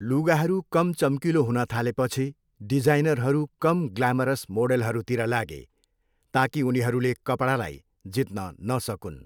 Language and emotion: Nepali, neutral